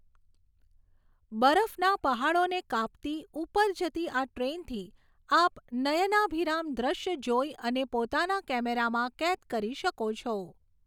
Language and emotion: Gujarati, neutral